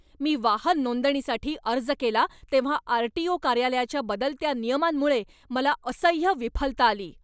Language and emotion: Marathi, angry